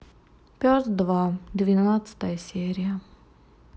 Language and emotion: Russian, sad